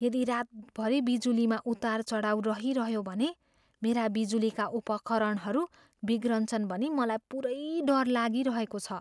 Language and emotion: Nepali, fearful